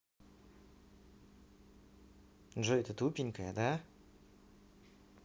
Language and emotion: Russian, neutral